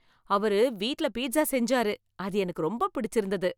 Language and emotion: Tamil, happy